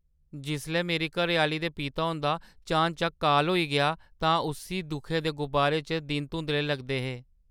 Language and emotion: Dogri, sad